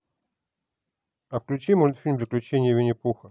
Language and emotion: Russian, neutral